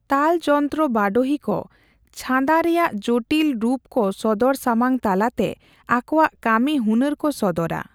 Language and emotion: Santali, neutral